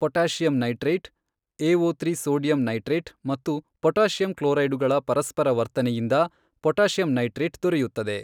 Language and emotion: Kannada, neutral